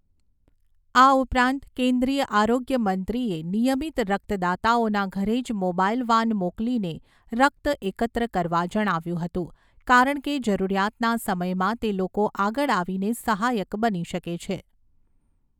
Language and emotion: Gujarati, neutral